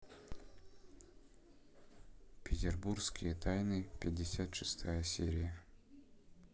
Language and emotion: Russian, neutral